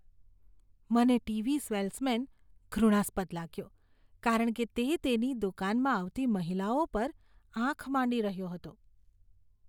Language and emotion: Gujarati, disgusted